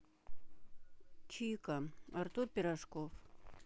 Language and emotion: Russian, neutral